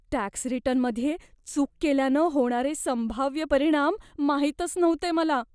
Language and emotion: Marathi, fearful